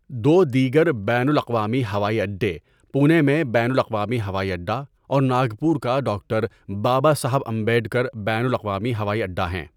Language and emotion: Urdu, neutral